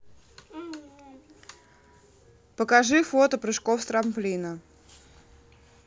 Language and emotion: Russian, neutral